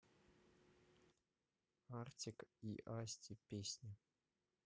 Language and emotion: Russian, neutral